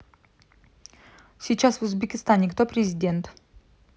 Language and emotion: Russian, neutral